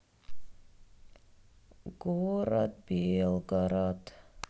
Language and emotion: Russian, sad